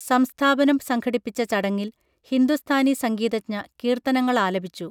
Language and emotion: Malayalam, neutral